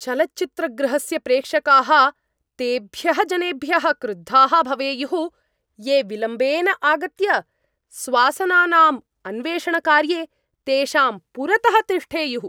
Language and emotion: Sanskrit, angry